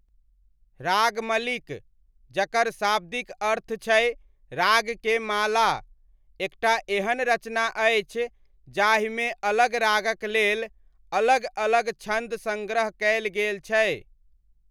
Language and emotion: Maithili, neutral